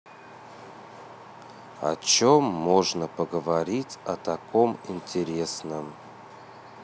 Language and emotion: Russian, neutral